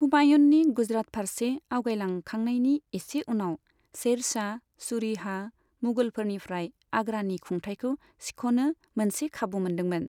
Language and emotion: Bodo, neutral